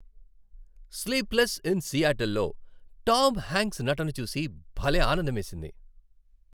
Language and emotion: Telugu, happy